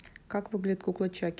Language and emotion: Russian, neutral